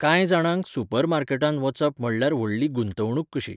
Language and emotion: Goan Konkani, neutral